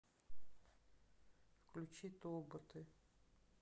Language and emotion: Russian, sad